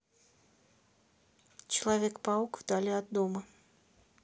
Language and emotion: Russian, neutral